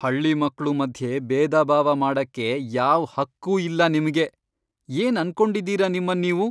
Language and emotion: Kannada, angry